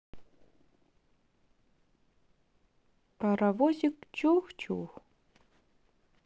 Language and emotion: Russian, neutral